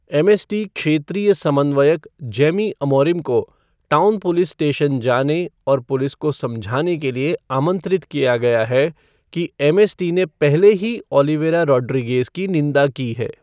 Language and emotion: Hindi, neutral